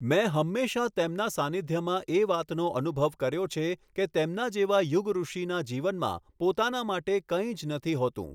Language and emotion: Gujarati, neutral